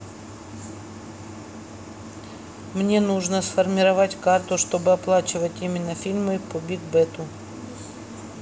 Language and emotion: Russian, neutral